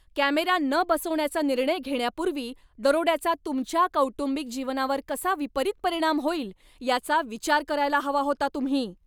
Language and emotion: Marathi, angry